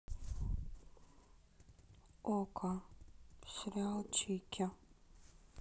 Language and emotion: Russian, neutral